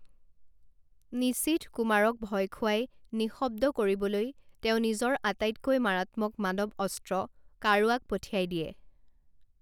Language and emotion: Assamese, neutral